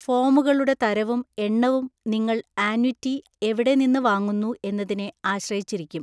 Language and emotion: Malayalam, neutral